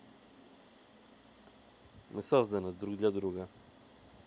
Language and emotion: Russian, neutral